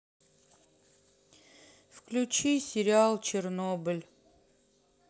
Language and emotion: Russian, sad